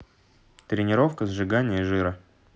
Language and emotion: Russian, neutral